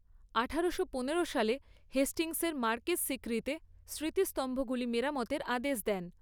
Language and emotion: Bengali, neutral